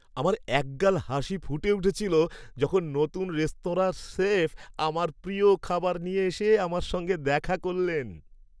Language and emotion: Bengali, happy